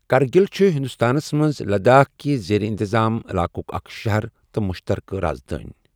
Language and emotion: Kashmiri, neutral